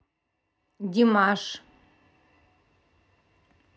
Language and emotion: Russian, neutral